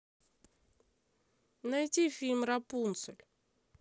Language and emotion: Russian, neutral